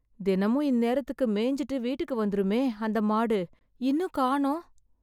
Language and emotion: Tamil, sad